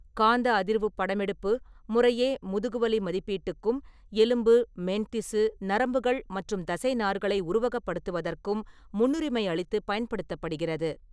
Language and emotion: Tamil, neutral